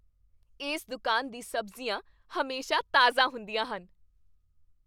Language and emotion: Punjabi, happy